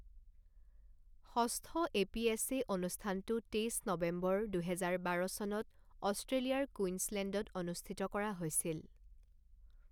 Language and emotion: Assamese, neutral